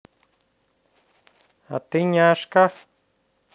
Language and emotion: Russian, neutral